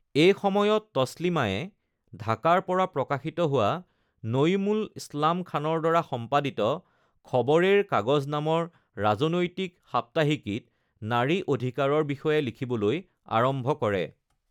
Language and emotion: Assamese, neutral